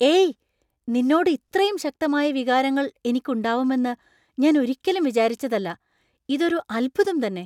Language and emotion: Malayalam, surprised